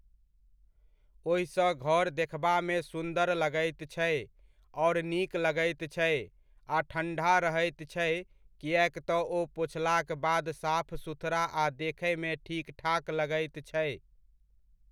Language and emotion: Maithili, neutral